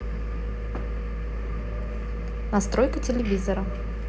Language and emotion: Russian, neutral